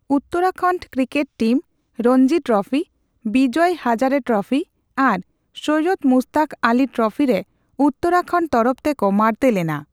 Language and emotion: Santali, neutral